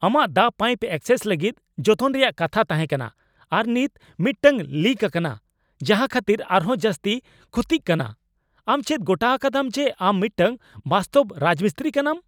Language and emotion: Santali, angry